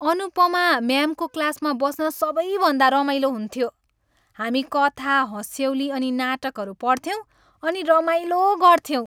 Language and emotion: Nepali, happy